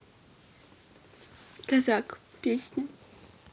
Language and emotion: Russian, neutral